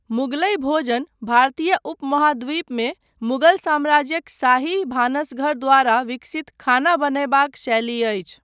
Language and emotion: Maithili, neutral